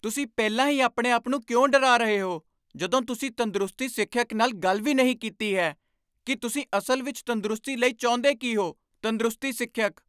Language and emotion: Punjabi, angry